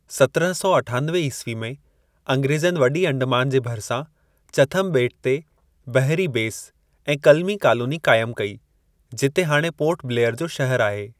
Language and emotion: Sindhi, neutral